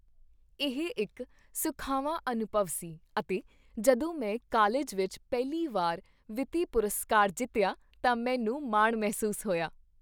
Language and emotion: Punjabi, happy